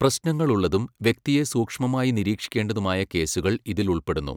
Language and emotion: Malayalam, neutral